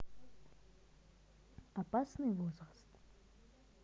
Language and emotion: Russian, neutral